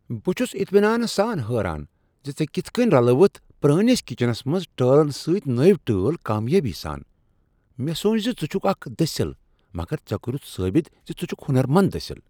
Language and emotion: Kashmiri, surprised